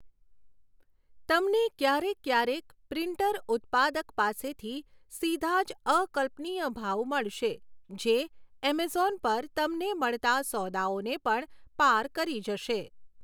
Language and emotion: Gujarati, neutral